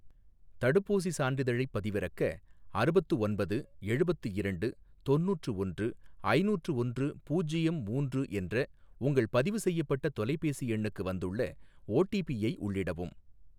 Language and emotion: Tamil, neutral